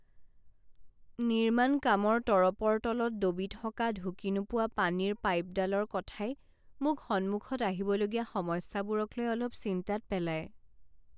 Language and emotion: Assamese, sad